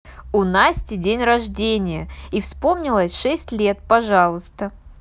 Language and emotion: Russian, positive